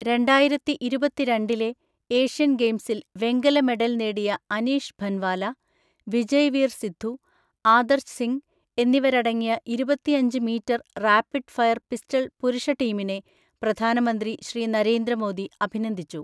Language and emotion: Malayalam, neutral